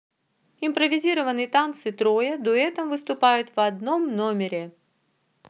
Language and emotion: Russian, neutral